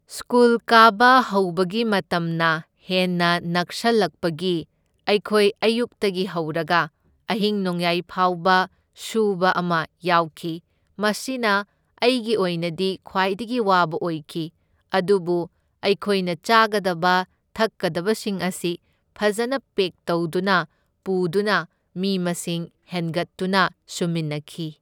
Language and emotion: Manipuri, neutral